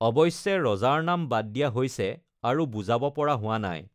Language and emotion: Assamese, neutral